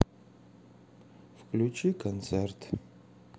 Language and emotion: Russian, sad